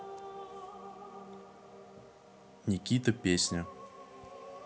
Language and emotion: Russian, neutral